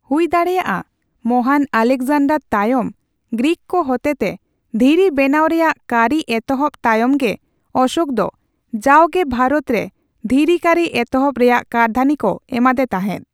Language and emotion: Santali, neutral